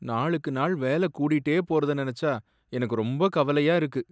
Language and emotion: Tamil, sad